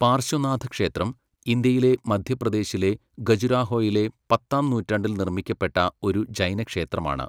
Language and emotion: Malayalam, neutral